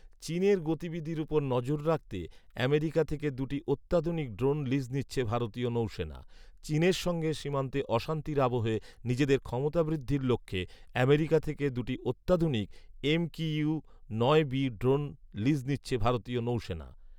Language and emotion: Bengali, neutral